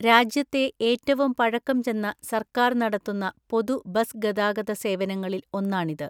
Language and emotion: Malayalam, neutral